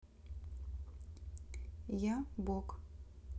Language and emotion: Russian, neutral